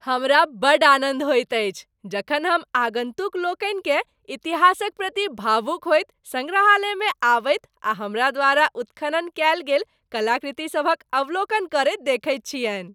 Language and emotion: Maithili, happy